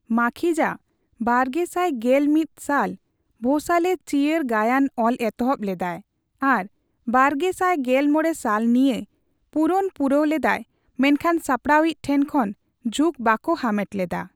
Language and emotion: Santali, neutral